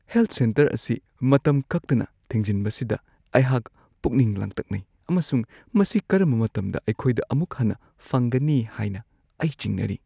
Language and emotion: Manipuri, fearful